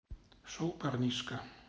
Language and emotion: Russian, neutral